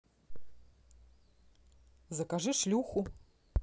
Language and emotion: Russian, neutral